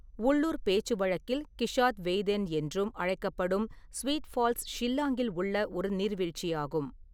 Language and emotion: Tamil, neutral